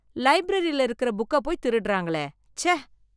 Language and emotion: Tamil, disgusted